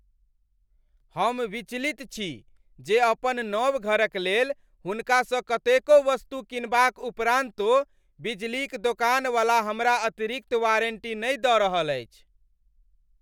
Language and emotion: Maithili, angry